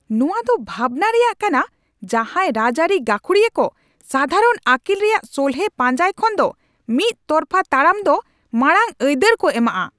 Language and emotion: Santali, angry